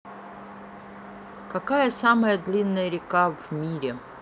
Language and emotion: Russian, neutral